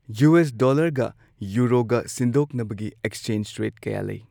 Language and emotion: Manipuri, neutral